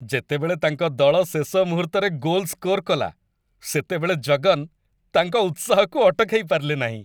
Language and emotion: Odia, happy